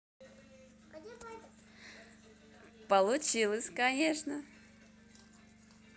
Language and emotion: Russian, positive